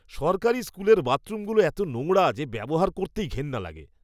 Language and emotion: Bengali, disgusted